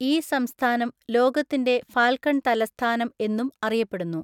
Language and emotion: Malayalam, neutral